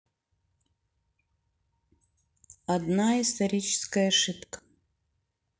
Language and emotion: Russian, neutral